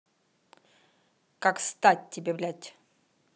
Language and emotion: Russian, angry